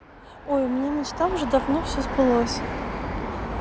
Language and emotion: Russian, neutral